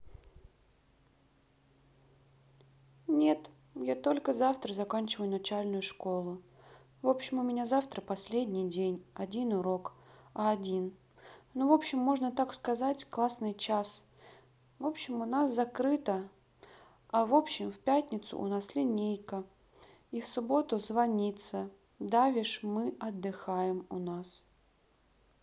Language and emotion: Russian, sad